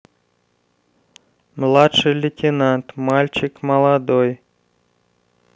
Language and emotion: Russian, neutral